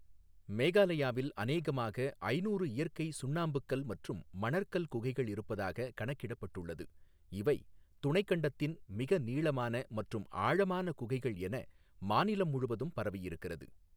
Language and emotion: Tamil, neutral